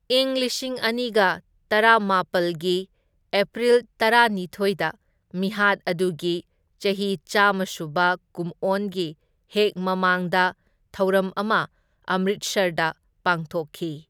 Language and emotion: Manipuri, neutral